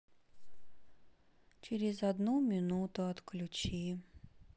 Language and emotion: Russian, sad